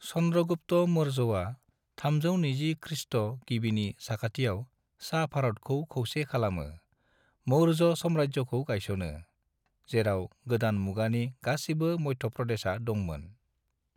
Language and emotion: Bodo, neutral